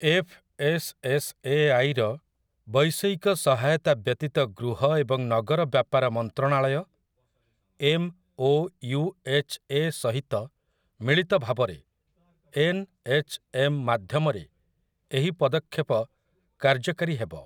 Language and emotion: Odia, neutral